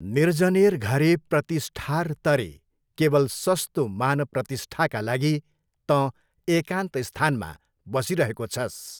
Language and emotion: Nepali, neutral